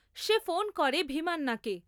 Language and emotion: Bengali, neutral